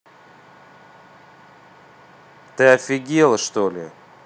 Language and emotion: Russian, angry